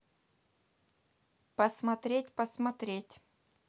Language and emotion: Russian, neutral